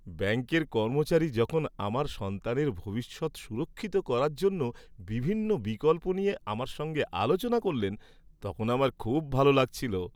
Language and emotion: Bengali, happy